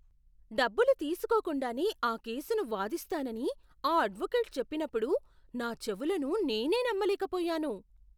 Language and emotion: Telugu, surprised